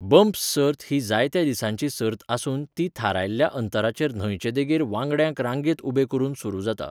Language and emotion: Goan Konkani, neutral